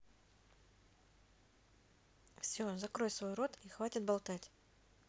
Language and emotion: Russian, neutral